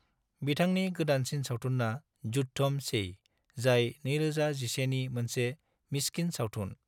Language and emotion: Bodo, neutral